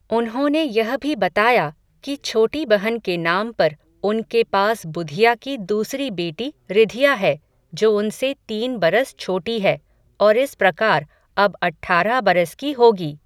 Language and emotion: Hindi, neutral